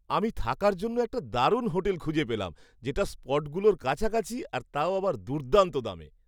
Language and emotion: Bengali, happy